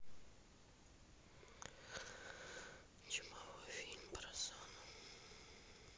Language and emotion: Russian, sad